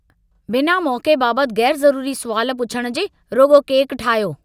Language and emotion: Sindhi, angry